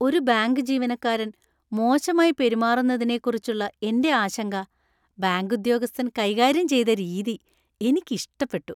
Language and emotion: Malayalam, happy